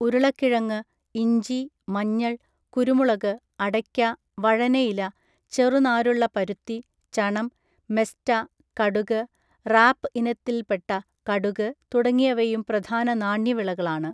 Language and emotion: Malayalam, neutral